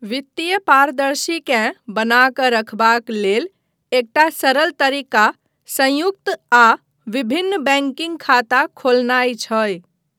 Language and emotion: Maithili, neutral